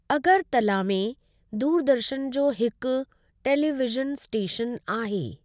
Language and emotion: Sindhi, neutral